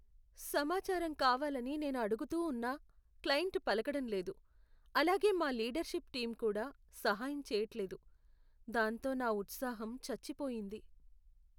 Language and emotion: Telugu, sad